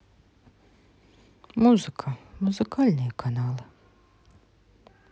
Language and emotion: Russian, sad